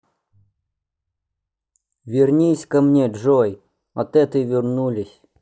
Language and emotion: Russian, neutral